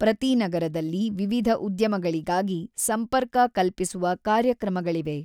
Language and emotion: Kannada, neutral